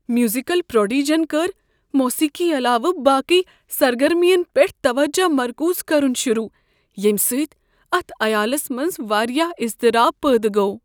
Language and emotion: Kashmiri, fearful